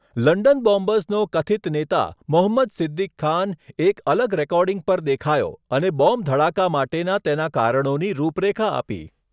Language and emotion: Gujarati, neutral